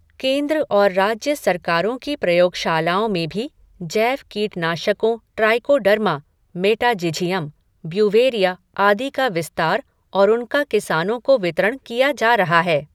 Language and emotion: Hindi, neutral